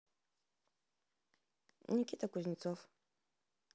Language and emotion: Russian, neutral